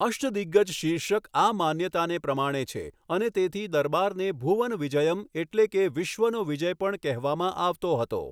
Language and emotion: Gujarati, neutral